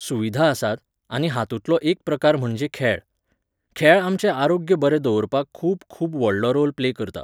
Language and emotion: Goan Konkani, neutral